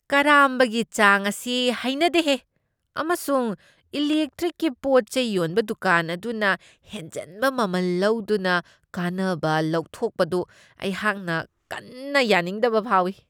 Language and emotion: Manipuri, disgusted